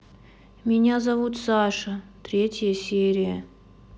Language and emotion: Russian, sad